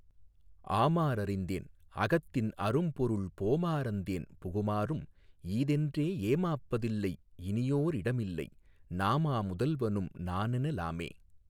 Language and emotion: Tamil, neutral